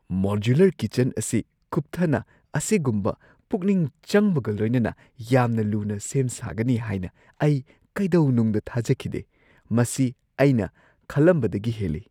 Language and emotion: Manipuri, surprised